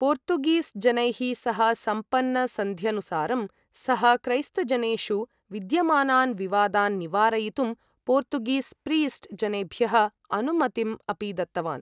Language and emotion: Sanskrit, neutral